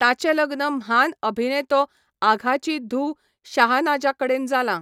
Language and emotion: Goan Konkani, neutral